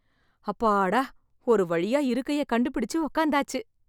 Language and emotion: Tamil, happy